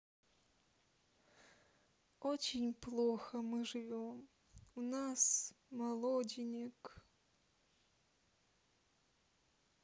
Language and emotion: Russian, sad